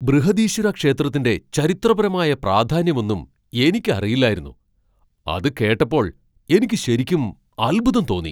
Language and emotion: Malayalam, surprised